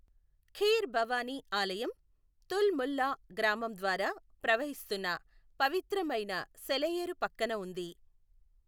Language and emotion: Telugu, neutral